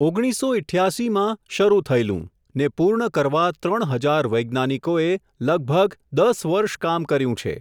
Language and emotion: Gujarati, neutral